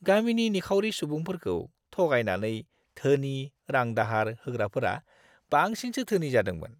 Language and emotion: Bodo, disgusted